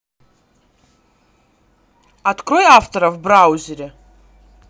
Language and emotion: Russian, neutral